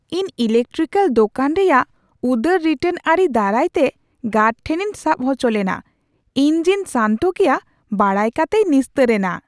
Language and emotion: Santali, surprised